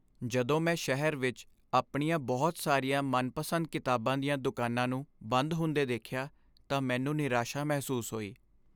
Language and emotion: Punjabi, sad